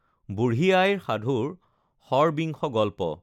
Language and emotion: Assamese, neutral